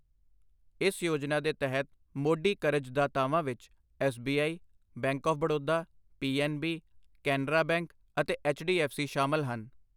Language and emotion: Punjabi, neutral